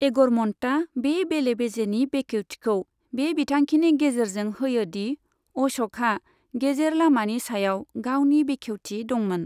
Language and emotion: Bodo, neutral